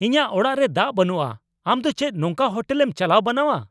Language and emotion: Santali, angry